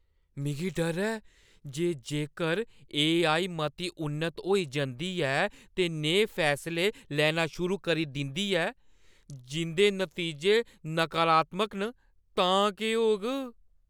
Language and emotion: Dogri, fearful